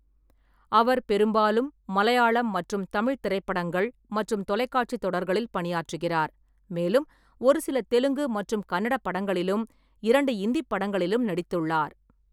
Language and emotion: Tamil, neutral